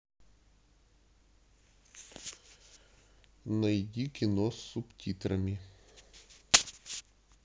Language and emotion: Russian, neutral